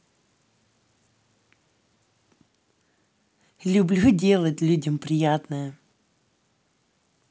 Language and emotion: Russian, positive